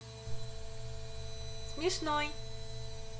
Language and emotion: Russian, positive